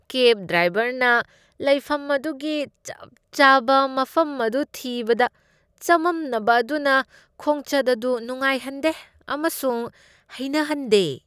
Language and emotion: Manipuri, disgusted